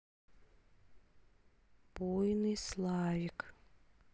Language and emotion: Russian, neutral